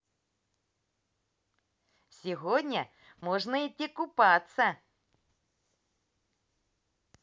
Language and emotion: Russian, positive